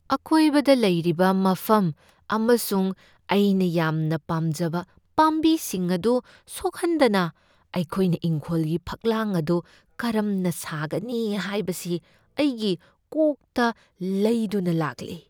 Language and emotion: Manipuri, fearful